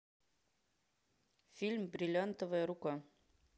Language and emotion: Russian, neutral